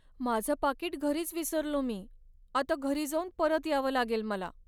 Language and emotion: Marathi, sad